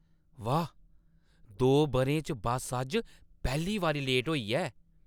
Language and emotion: Dogri, surprised